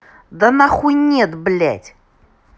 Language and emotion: Russian, angry